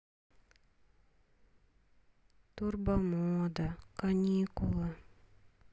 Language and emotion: Russian, sad